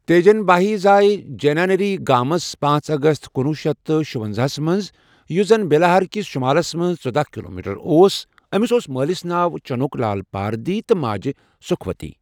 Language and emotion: Kashmiri, neutral